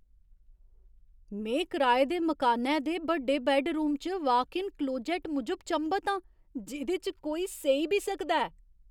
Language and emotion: Dogri, surprised